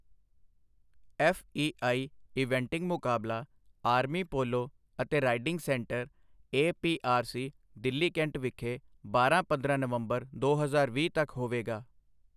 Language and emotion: Punjabi, neutral